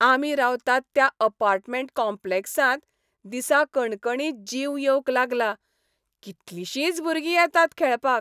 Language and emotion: Goan Konkani, happy